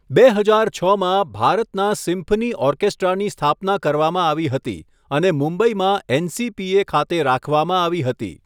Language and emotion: Gujarati, neutral